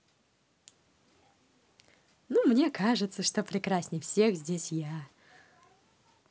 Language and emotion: Russian, positive